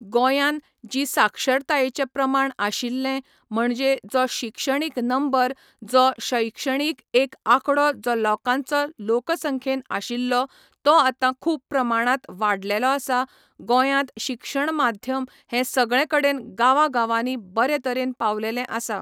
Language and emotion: Goan Konkani, neutral